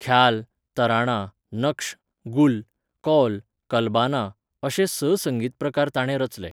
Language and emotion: Goan Konkani, neutral